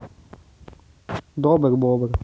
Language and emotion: Russian, neutral